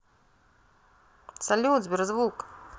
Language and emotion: Russian, positive